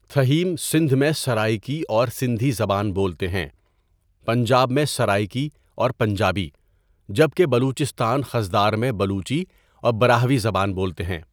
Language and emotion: Urdu, neutral